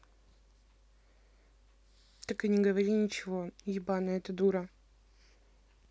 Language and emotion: Russian, neutral